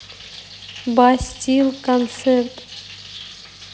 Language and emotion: Russian, neutral